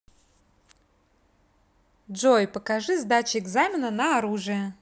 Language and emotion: Russian, positive